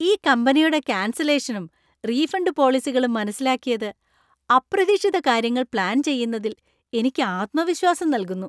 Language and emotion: Malayalam, happy